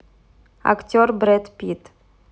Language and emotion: Russian, neutral